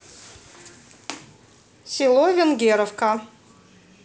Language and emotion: Russian, neutral